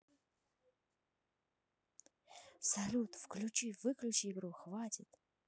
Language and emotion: Russian, neutral